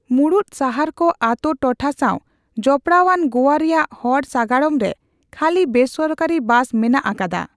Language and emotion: Santali, neutral